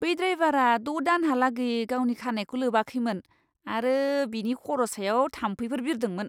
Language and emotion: Bodo, disgusted